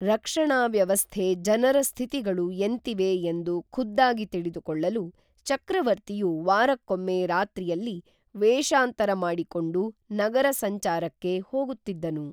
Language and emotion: Kannada, neutral